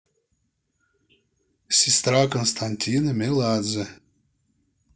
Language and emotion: Russian, neutral